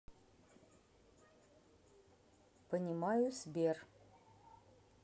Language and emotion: Russian, neutral